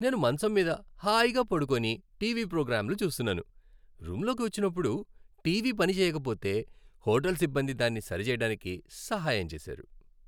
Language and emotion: Telugu, happy